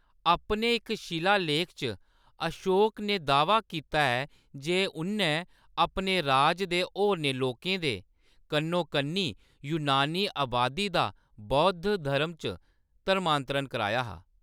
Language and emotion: Dogri, neutral